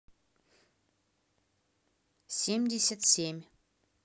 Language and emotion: Russian, neutral